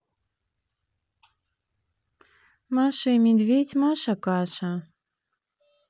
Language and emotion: Russian, neutral